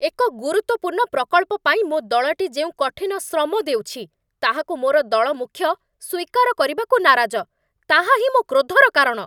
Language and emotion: Odia, angry